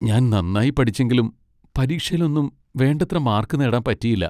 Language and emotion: Malayalam, sad